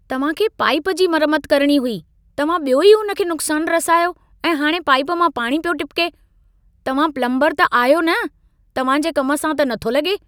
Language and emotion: Sindhi, angry